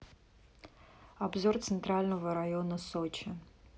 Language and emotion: Russian, neutral